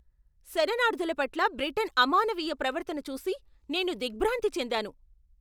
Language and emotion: Telugu, angry